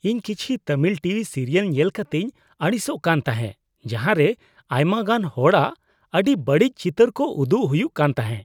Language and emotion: Santali, disgusted